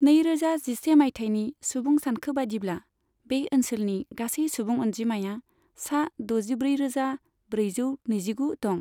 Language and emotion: Bodo, neutral